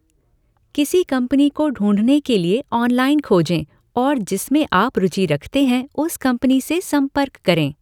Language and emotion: Hindi, neutral